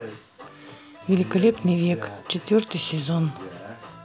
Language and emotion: Russian, neutral